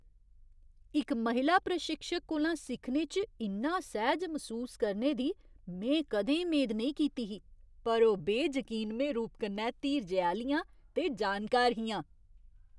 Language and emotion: Dogri, surprised